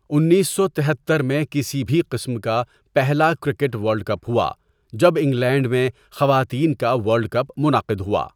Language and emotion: Urdu, neutral